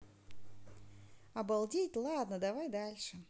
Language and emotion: Russian, positive